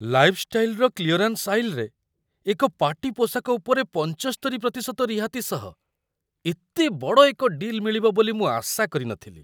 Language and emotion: Odia, surprised